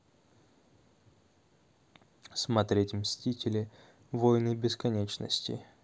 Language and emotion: Russian, neutral